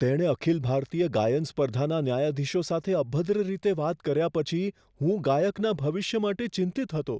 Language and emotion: Gujarati, fearful